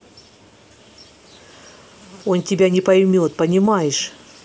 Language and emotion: Russian, angry